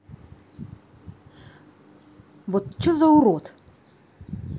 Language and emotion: Russian, angry